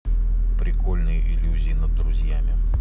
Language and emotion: Russian, neutral